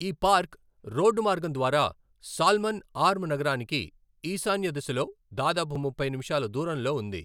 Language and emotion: Telugu, neutral